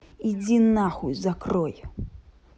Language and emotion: Russian, angry